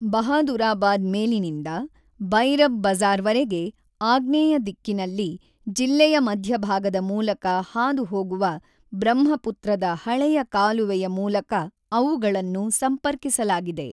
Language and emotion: Kannada, neutral